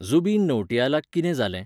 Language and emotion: Goan Konkani, neutral